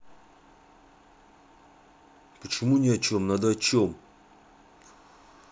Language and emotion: Russian, angry